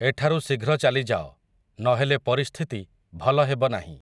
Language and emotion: Odia, neutral